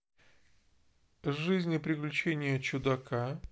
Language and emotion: Russian, neutral